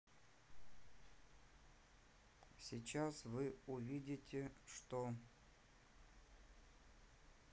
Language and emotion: Russian, neutral